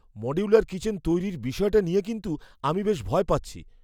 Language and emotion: Bengali, fearful